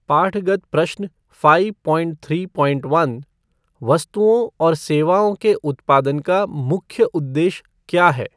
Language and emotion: Hindi, neutral